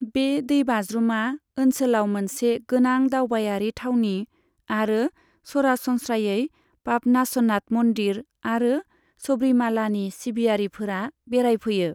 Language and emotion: Bodo, neutral